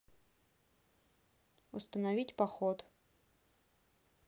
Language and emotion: Russian, neutral